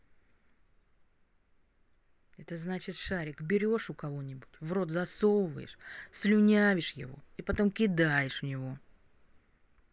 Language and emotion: Russian, angry